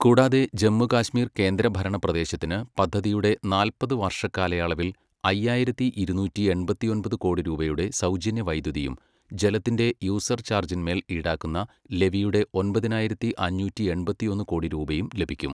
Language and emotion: Malayalam, neutral